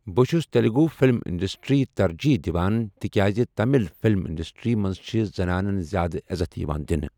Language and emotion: Kashmiri, neutral